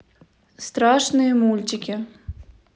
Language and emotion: Russian, neutral